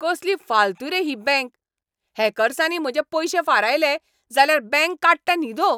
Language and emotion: Goan Konkani, angry